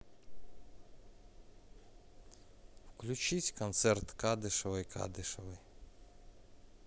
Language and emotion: Russian, neutral